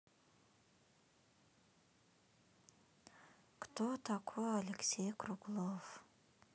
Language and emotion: Russian, sad